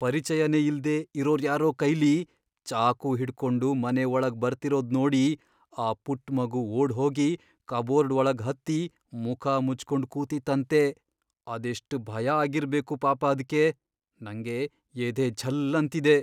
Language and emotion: Kannada, fearful